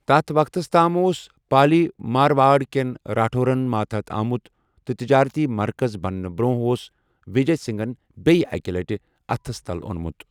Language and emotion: Kashmiri, neutral